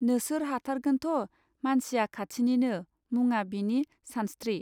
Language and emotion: Bodo, neutral